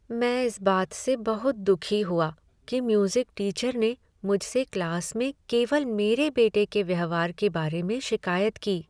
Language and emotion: Hindi, sad